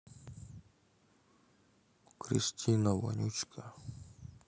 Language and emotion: Russian, sad